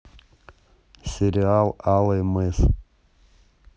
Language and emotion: Russian, neutral